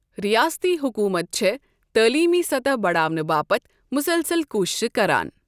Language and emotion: Kashmiri, neutral